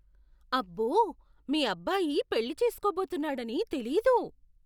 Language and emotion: Telugu, surprised